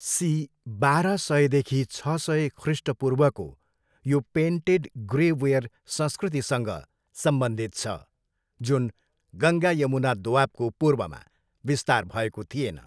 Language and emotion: Nepali, neutral